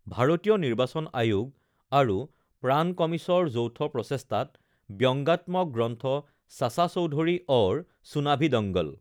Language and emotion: Assamese, neutral